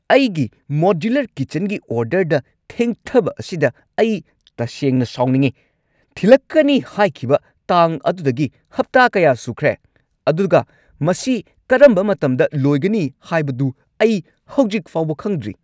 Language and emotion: Manipuri, angry